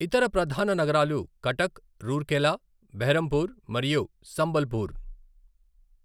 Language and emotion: Telugu, neutral